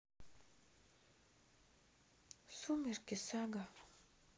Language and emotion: Russian, sad